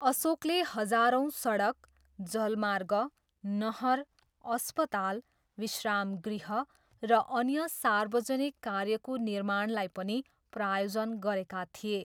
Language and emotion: Nepali, neutral